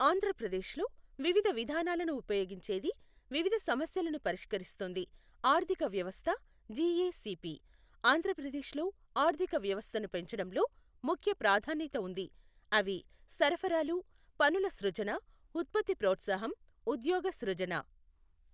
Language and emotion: Telugu, neutral